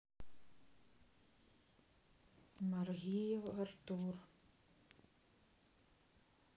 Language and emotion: Russian, sad